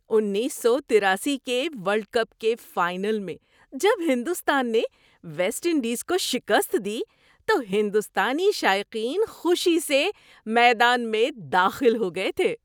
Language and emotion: Urdu, happy